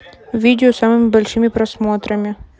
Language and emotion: Russian, neutral